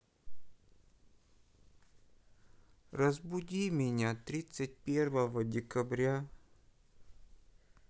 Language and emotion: Russian, sad